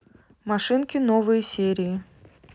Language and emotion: Russian, neutral